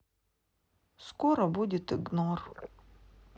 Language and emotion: Russian, sad